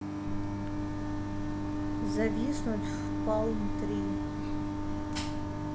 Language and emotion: Russian, neutral